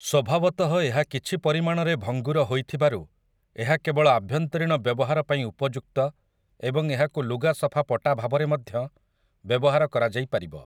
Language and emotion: Odia, neutral